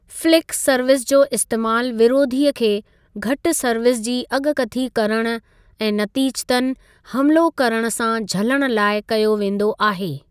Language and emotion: Sindhi, neutral